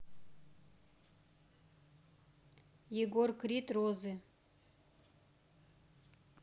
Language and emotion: Russian, neutral